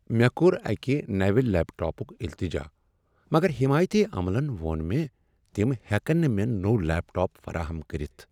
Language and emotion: Kashmiri, sad